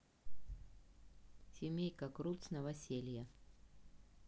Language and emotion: Russian, neutral